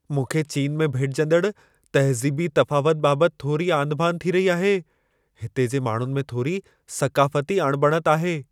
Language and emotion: Sindhi, fearful